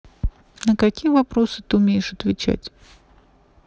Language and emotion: Russian, neutral